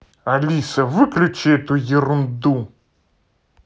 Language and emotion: Russian, angry